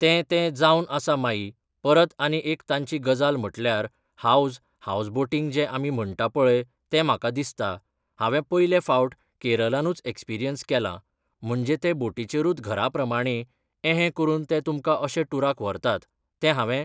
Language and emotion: Goan Konkani, neutral